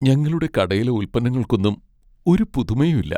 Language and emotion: Malayalam, sad